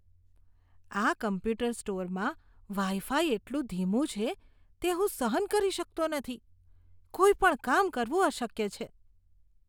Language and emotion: Gujarati, disgusted